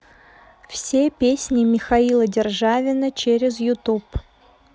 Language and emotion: Russian, neutral